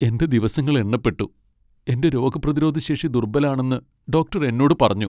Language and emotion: Malayalam, sad